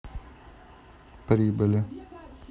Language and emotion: Russian, neutral